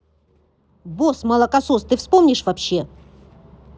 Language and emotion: Russian, angry